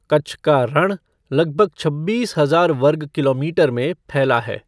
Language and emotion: Hindi, neutral